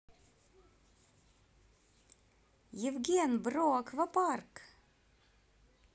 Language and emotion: Russian, positive